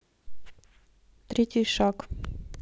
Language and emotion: Russian, neutral